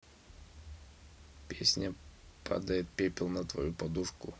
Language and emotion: Russian, neutral